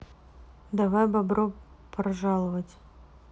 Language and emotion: Russian, neutral